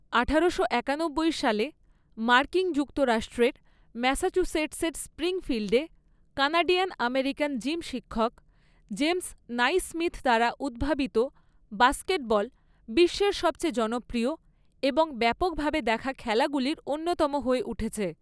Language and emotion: Bengali, neutral